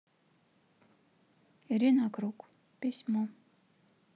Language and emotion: Russian, neutral